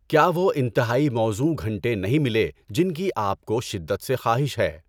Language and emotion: Urdu, neutral